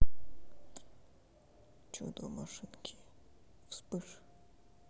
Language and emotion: Russian, neutral